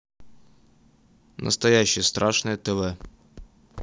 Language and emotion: Russian, neutral